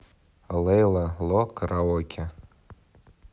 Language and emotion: Russian, neutral